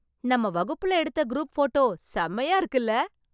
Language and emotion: Tamil, happy